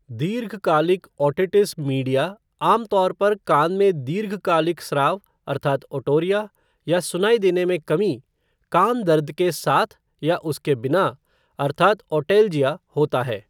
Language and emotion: Hindi, neutral